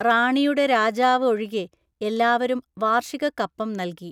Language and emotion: Malayalam, neutral